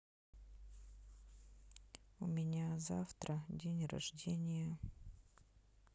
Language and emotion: Russian, sad